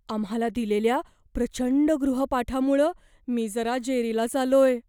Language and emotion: Marathi, fearful